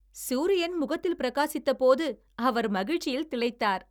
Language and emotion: Tamil, happy